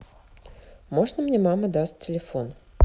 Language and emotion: Russian, neutral